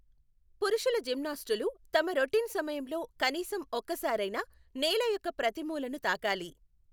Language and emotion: Telugu, neutral